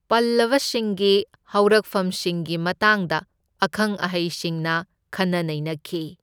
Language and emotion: Manipuri, neutral